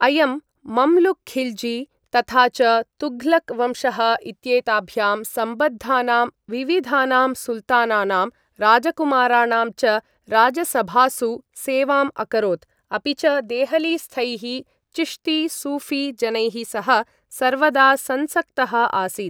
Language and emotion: Sanskrit, neutral